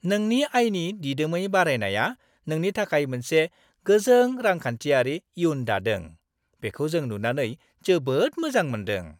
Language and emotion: Bodo, happy